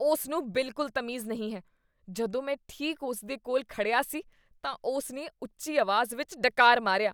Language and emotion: Punjabi, disgusted